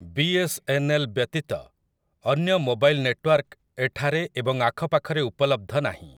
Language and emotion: Odia, neutral